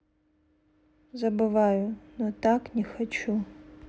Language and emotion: Russian, sad